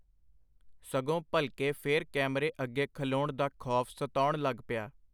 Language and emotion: Punjabi, neutral